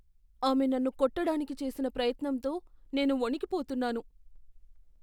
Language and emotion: Telugu, fearful